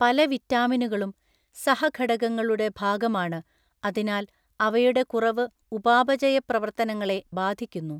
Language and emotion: Malayalam, neutral